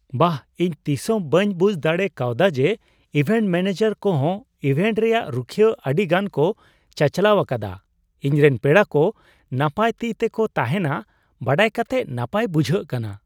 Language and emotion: Santali, surprised